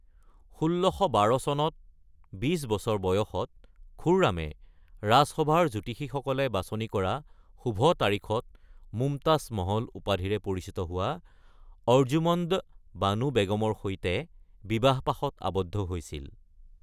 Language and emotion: Assamese, neutral